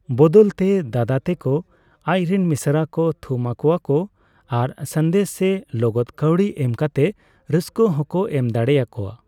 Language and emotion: Santali, neutral